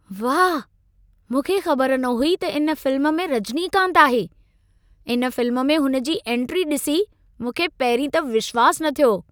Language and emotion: Sindhi, surprised